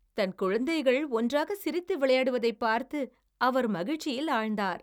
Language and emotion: Tamil, happy